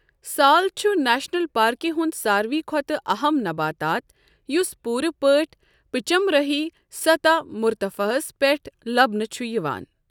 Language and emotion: Kashmiri, neutral